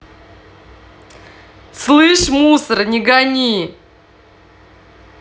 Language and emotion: Russian, angry